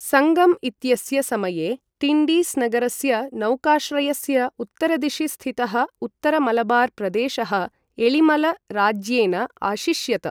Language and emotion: Sanskrit, neutral